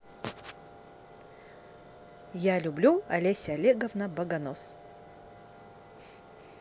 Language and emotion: Russian, positive